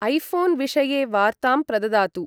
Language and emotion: Sanskrit, neutral